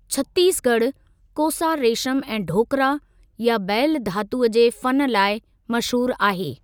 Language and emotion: Sindhi, neutral